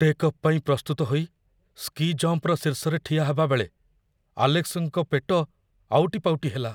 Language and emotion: Odia, fearful